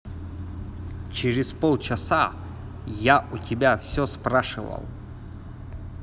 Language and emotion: Russian, angry